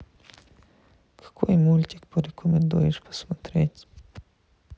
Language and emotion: Russian, sad